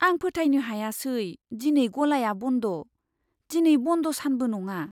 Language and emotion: Bodo, surprised